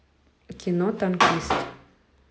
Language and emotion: Russian, neutral